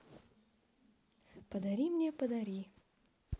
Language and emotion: Russian, neutral